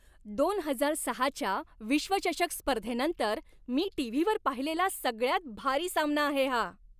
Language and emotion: Marathi, happy